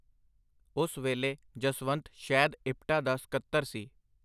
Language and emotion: Punjabi, neutral